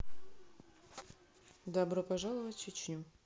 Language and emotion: Russian, neutral